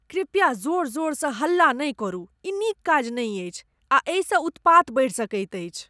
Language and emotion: Maithili, disgusted